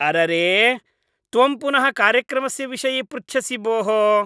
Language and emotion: Sanskrit, disgusted